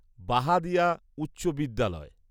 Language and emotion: Bengali, neutral